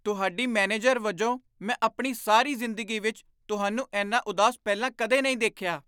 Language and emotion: Punjabi, surprised